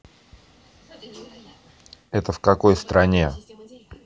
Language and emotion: Russian, neutral